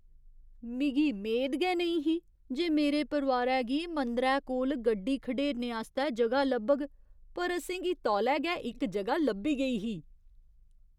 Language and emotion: Dogri, surprised